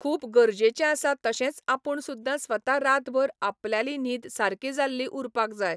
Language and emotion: Goan Konkani, neutral